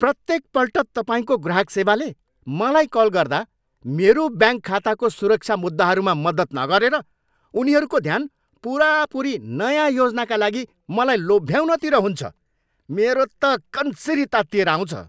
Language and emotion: Nepali, angry